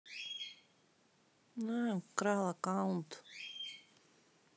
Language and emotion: Russian, sad